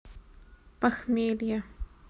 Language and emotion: Russian, neutral